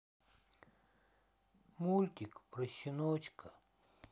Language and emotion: Russian, sad